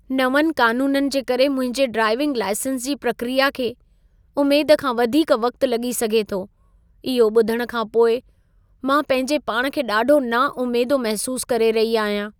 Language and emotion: Sindhi, sad